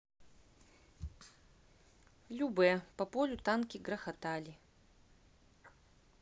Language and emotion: Russian, neutral